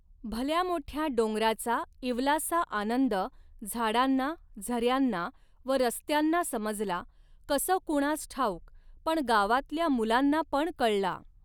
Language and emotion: Marathi, neutral